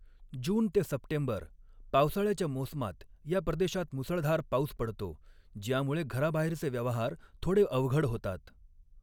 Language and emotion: Marathi, neutral